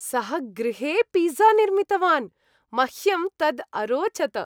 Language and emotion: Sanskrit, happy